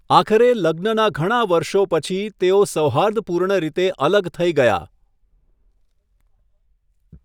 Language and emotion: Gujarati, neutral